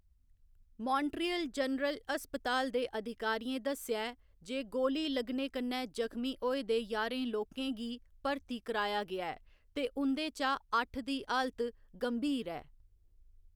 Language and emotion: Dogri, neutral